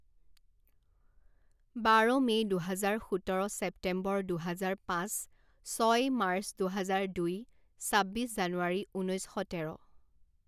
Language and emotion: Assamese, neutral